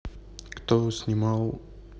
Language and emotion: Russian, neutral